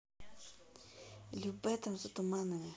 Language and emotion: Russian, neutral